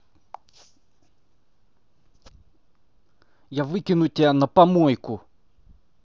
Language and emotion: Russian, angry